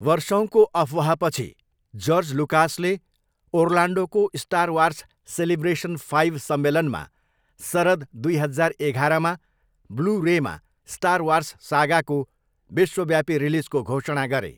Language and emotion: Nepali, neutral